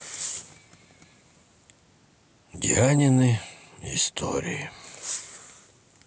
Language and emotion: Russian, sad